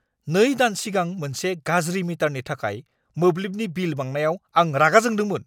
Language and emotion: Bodo, angry